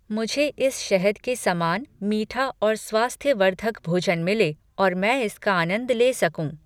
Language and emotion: Hindi, neutral